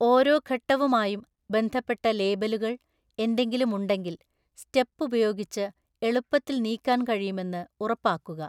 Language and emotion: Malayalam, neutral